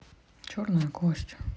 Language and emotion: Russian, neutral